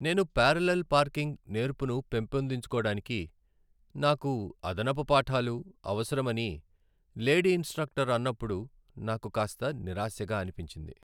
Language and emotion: Telugu, sad